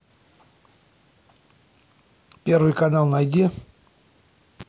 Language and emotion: Russian, angry